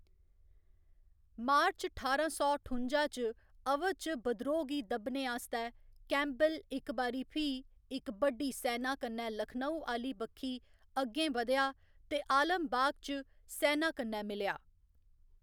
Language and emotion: Dogri, neutral